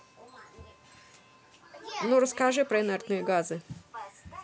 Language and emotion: Russian, neutral